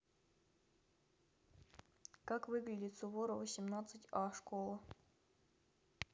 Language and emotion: Russian, neutral